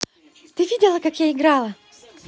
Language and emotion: Russian, positive